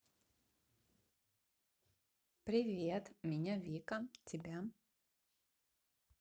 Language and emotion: Russian, positive